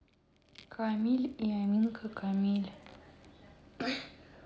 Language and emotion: Russian, neutral